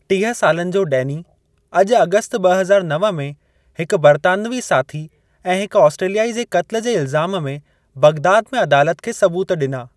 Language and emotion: Sindhi, neutral